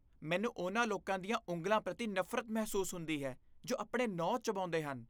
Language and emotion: Punjabi, disgusted